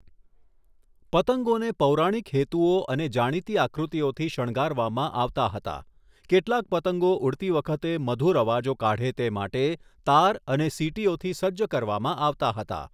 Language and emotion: Gujarati, neutral